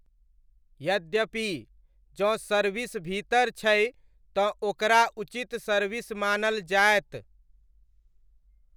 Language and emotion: Maithili, neutral